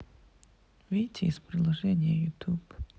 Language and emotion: Russian, sad